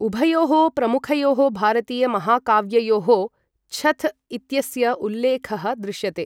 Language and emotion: Sanskrit, neutral